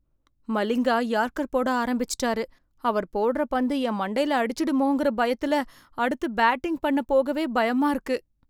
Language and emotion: Tamil, fearful